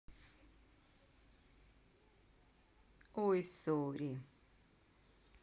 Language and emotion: Russian, neutral